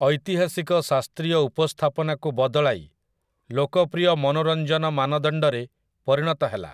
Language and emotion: Odia, neutral